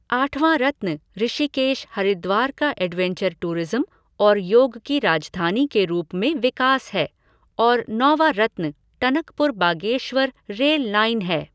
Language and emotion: Hindi, neutral